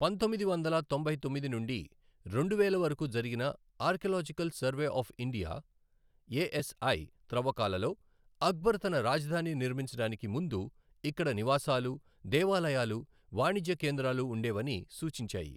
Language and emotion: Telugu, neutral